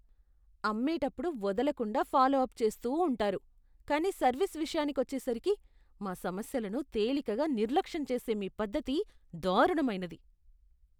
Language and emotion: Telugu, disgusted